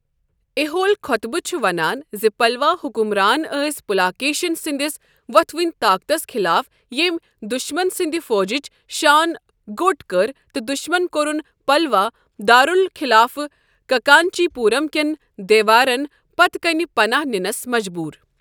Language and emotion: Kashmiri, neutral